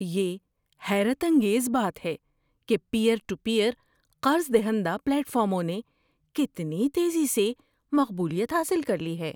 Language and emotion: Urdu, surprised